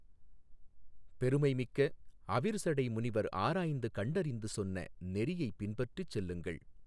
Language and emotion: Tamil, neutral